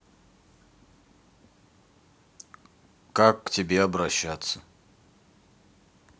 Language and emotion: Russian, neutral